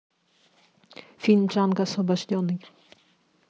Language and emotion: Russian, neutral